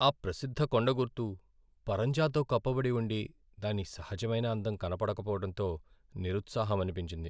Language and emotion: Telugu, sad